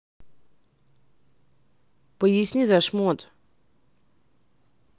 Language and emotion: Russian, neutral